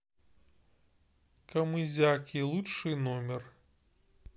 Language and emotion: Russian, neutral